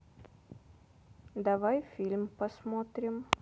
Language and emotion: Russian, neutral